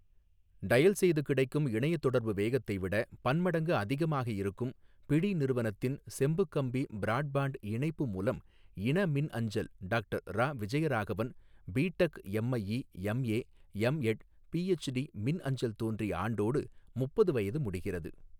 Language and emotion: Tamil, neutral